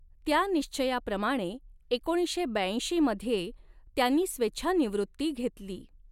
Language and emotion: Marathi, neutral